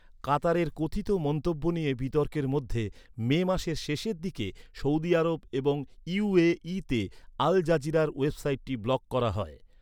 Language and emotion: Bengali, neutral